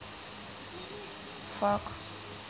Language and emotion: Russian, neutral